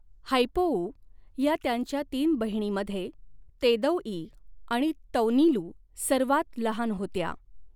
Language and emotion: Marathi, neutral